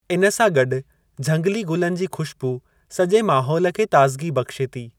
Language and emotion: Sindhi, neutral